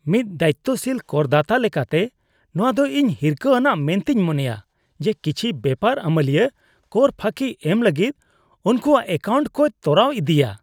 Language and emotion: Santali, disgusted